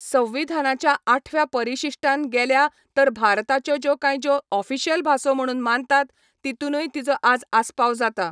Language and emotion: Goan Konkani, neutral